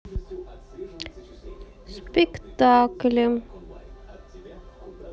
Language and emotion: Russian, neutral